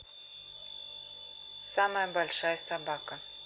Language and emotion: Russian, neutral